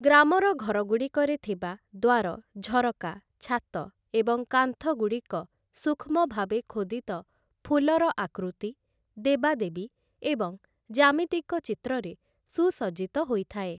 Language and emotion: Odia, neutral